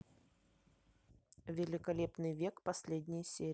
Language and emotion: Russian, neutral